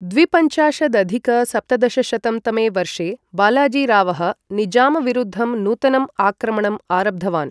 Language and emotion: Sanskrit, neutral